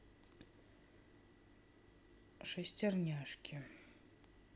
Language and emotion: Russian, neutral